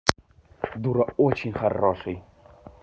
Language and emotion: Russian, positive